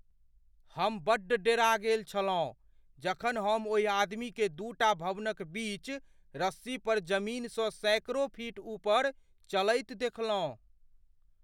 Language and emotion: Maithili, fearful